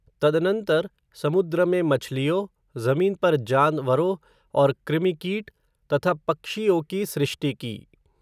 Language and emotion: Hindi, neutral